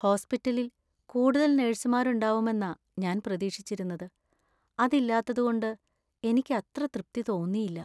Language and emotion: Malayalam, sad